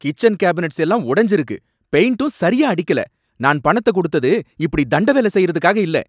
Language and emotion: Tamil, angry